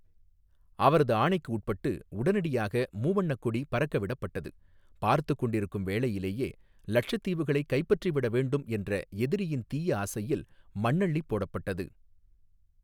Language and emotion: Tamil, neutral